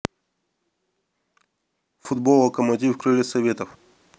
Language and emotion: Russian, neutral